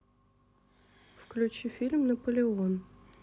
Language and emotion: Russian, neutral